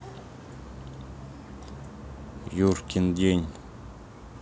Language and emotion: Russian, neutral